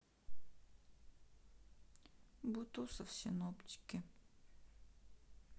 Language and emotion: Russian, neutral